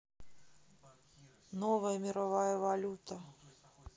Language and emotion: Russian, neutral